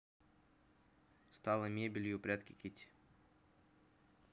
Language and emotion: Russian, neutral